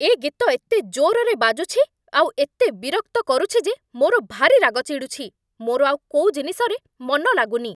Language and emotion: Odia, angry